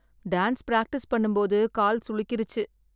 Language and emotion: Tamil, sad